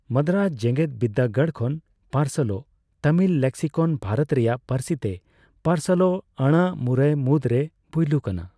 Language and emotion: Santali, neutral